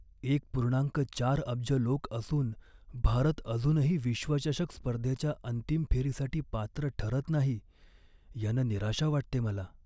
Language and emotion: Marathi, sad